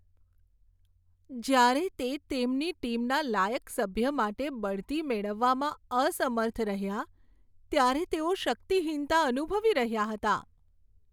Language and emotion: Gujarati, sad